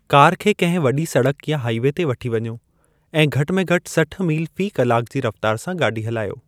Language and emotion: Sindhi, neutral